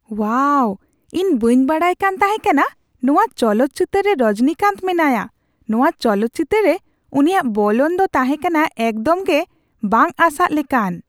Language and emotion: Santali, surprised